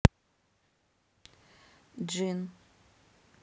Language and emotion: Russian, neutral